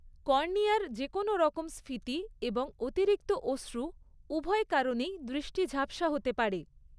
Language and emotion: Bengali, neutral